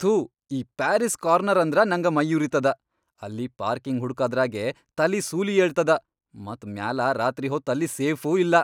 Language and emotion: Kannada, angry